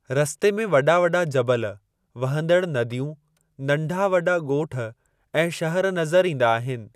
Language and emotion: Sindhi, neutral